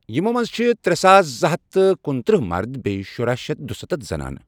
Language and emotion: Kashmiri, neutral